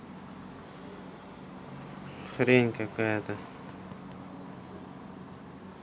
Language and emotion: Russian, neutral